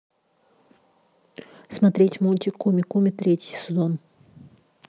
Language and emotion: Russian, neutral